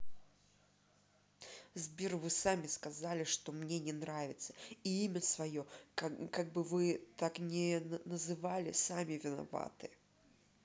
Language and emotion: Russian, angry